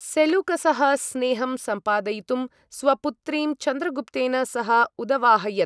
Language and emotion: Sanskrit, neutral